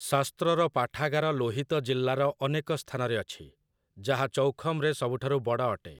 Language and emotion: Odia, neutral